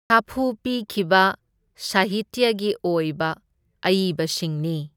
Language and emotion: Manipuri, neutral